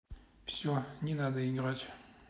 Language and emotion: Russian, angry